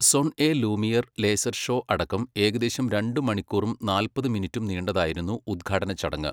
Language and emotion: Malayalam, neutral